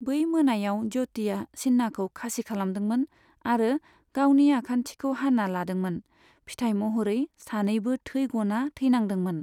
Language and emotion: Bodo, neutral